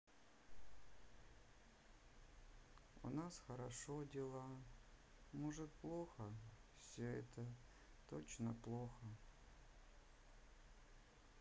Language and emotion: Russian, sad